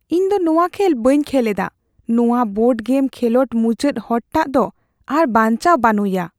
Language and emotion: Santali, fearful